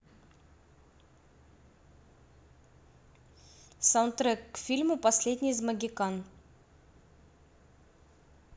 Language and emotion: Russian, neutral